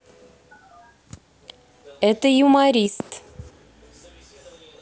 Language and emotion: Russian, neutral